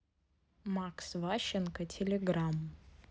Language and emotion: Russian, neutral